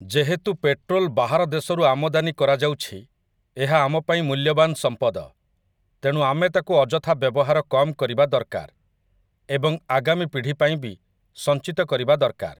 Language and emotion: Odia, neutral